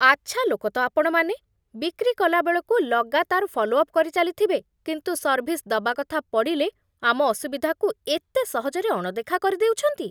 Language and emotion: Odia, disgusted